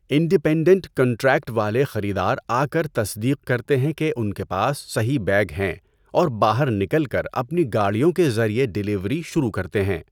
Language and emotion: Urdu, neutral